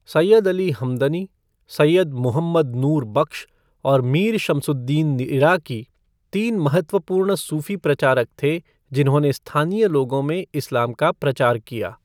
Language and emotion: Hindi, neutral